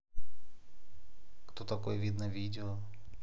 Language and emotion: Russian, neutral